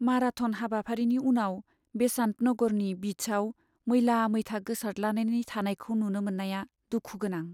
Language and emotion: Bodo, sad